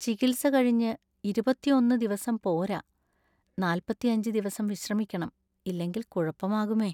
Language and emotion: Malayalam, sad